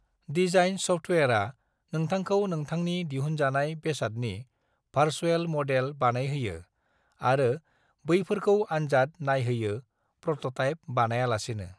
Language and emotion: Bodo, neutral